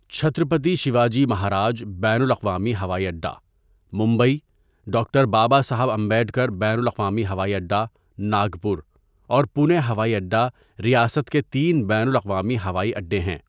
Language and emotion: Urdu, neutral